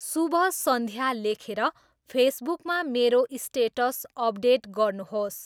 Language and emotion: Nepali, neutral